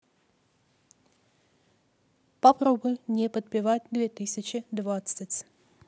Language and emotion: Russian, neutral